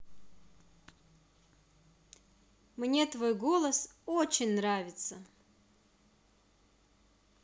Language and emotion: Russian, positive